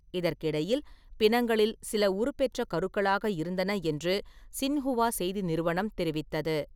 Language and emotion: Tamil, neutral